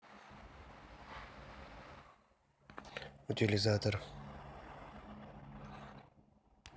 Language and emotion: Russian, neutral